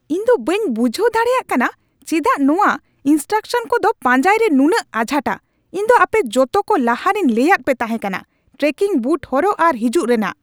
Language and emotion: Santali, angry